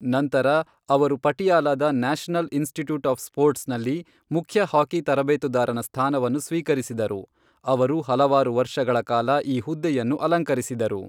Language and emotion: Kannada, neutral